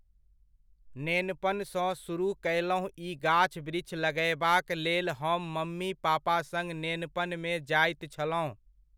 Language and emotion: Maithili, neutral